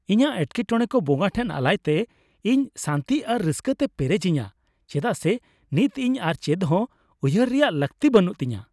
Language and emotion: Santali, happy